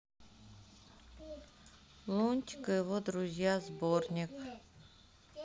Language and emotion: Russian, neutral